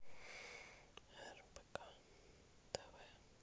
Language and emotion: Russian, neutral